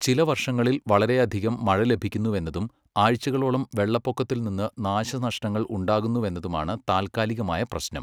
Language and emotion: Malayalam, neutral